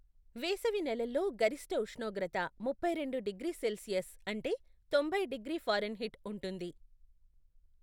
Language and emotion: Telugu, neutral